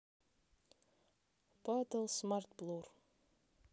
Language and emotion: Russian, neutral